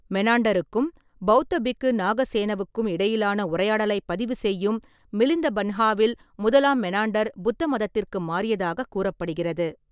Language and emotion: Tamil, neutral